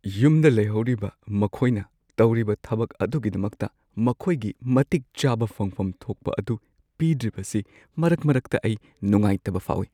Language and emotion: Manipuri, sad